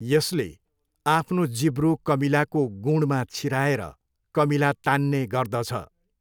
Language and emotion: Nepali, neutral